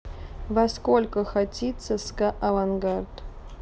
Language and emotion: Russian, neutral